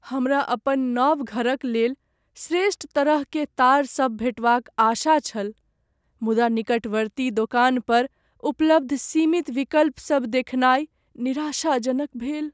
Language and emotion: Maithili, sad